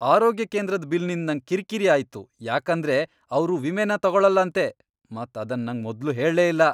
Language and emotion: Kannada, angry